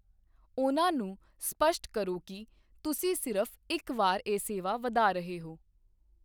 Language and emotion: Punjabi, neutral